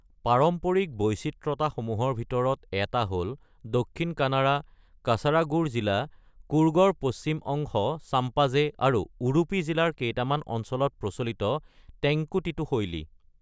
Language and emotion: Assamese, neutral